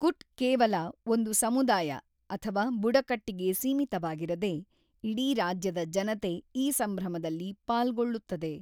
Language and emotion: Kannada, neutral